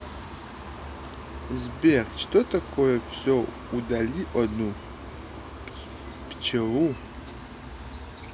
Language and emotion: Russian, neutral